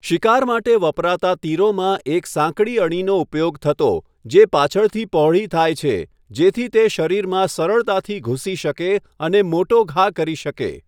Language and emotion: Gujarati, neutral